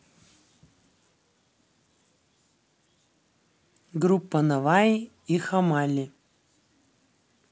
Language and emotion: Russian, neutral